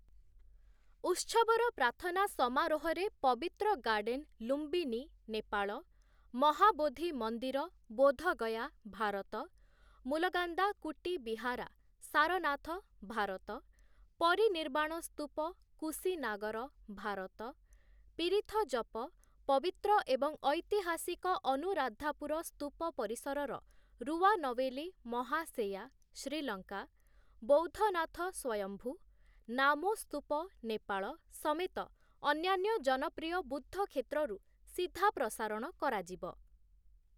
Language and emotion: Odia, neutral